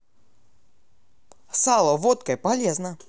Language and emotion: Russian, positive